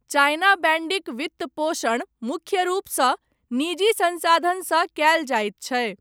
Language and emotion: Maithili, neutral